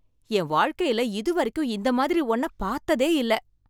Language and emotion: Tamil, surprised